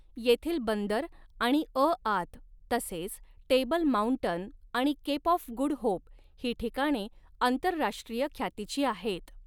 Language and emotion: Marathi, neutral